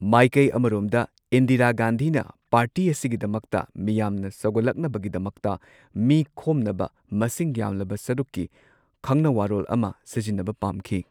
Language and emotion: Manipuri, neutral